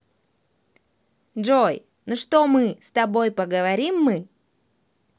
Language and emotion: Russian, positive